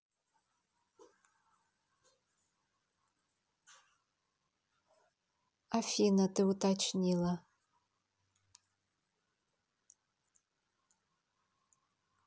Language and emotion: Russian, neutral